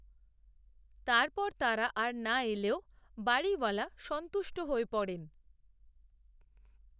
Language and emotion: Bengali, neutral